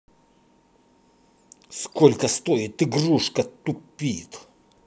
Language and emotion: Russian, angry